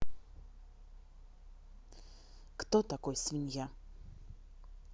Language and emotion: Russian, neutral